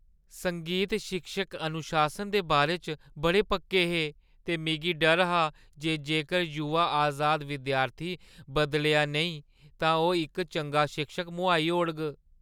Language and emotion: Dogri, fearful